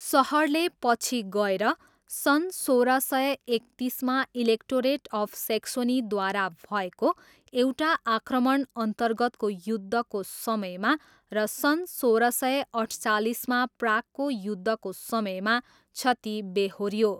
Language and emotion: Nepali, neutral